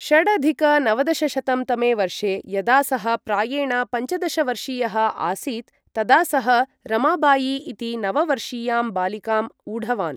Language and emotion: Sanskrit, neutral